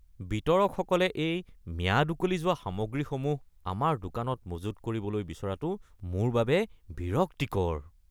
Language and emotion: Assamese, disgusted